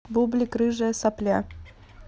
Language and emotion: Russian, neutral